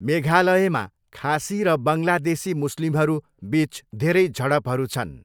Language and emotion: Nepali, neutral